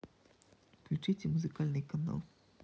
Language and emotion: Russian, neutral